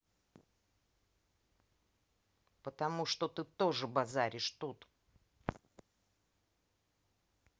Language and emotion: Russian, angry